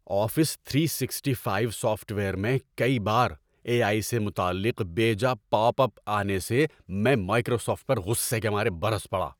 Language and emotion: Urdu, angry